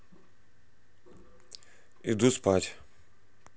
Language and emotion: Russian, neutral